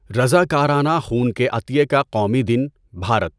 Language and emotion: Urdu, neutral